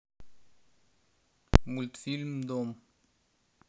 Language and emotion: Russian, neutral